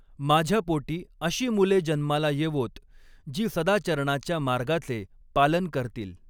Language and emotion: Marathi, neutral